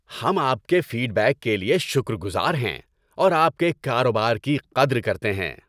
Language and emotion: Urdu, happy